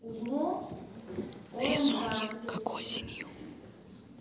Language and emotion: Russian, neutral